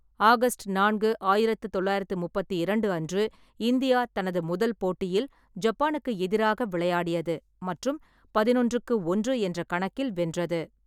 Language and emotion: Tamil, neutral